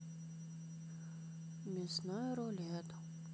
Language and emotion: Russian, sad